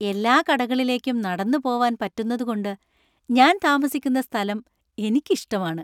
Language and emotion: Malayalam, happy